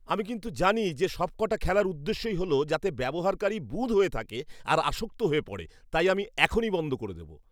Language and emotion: Bengali, disgusted